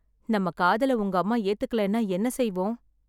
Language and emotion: Tamil, sad